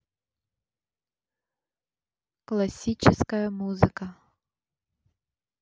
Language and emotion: Russian, neutral